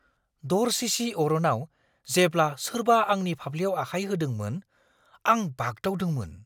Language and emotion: Bodo, surprised